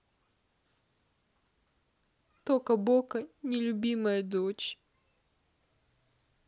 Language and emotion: Russian, sad